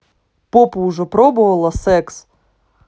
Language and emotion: Russian, angry